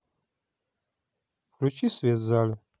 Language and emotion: Russian, neutral